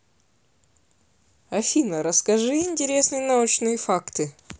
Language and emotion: Russian, neutral